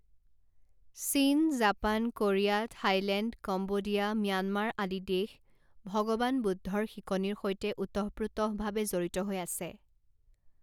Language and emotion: Assamese, neutral